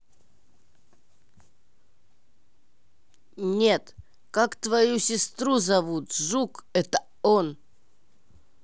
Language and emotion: Russian, angry